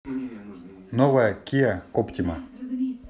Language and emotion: Russian, neutral